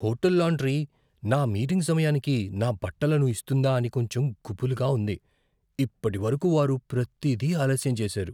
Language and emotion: Telugu, fearful